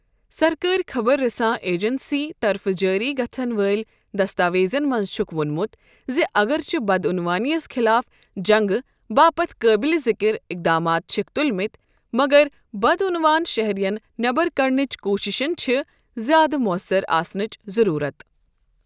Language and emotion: Kashmiri, neutral